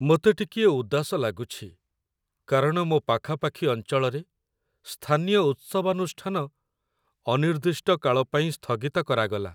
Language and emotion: Odia, sad